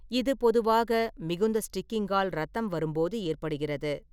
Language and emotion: Tamil, neutral